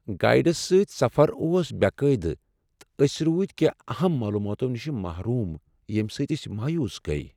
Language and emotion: Kashmiri, sad